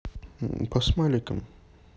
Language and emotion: Russian, neutral